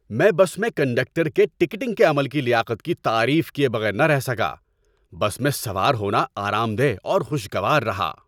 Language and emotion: Urdu, happy